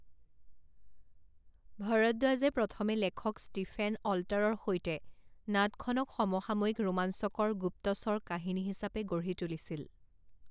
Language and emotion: Assamese, neutral